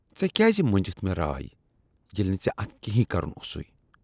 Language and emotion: Kashmiri, disgusted